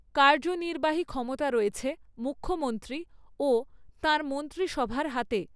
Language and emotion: Bengali, neutral